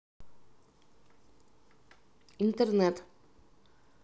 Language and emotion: Russian, neutral